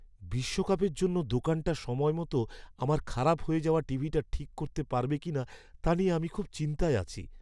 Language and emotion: Bengali, fearful